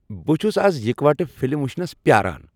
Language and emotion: Kashmiri, happy